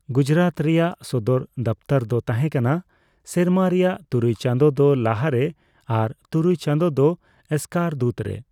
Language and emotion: Santali, neutral